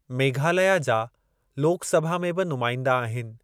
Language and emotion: Sindhi, neutral